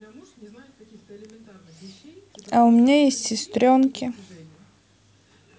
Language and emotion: Russian, neutral